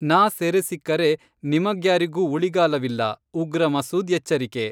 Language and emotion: Kannada, neutral